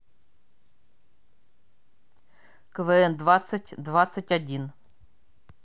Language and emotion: Russian, neutral